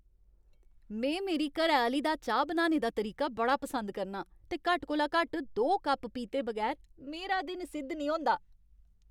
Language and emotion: Dogri, happy